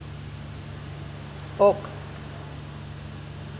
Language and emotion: Russian, neutral